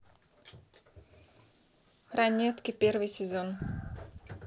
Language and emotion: Russian, neutral